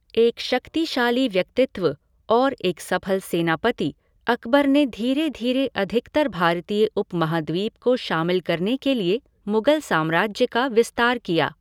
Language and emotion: Hindi, neutral